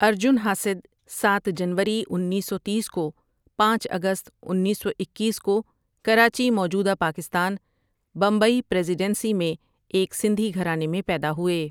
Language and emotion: Urdu, neutral